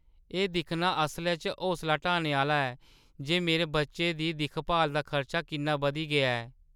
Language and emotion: Dogri, sad